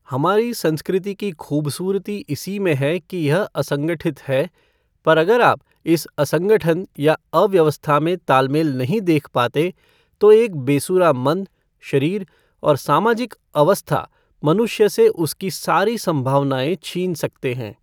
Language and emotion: Hindi, neutral